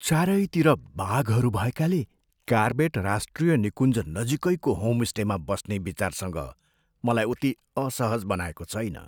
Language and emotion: Nepali, fearful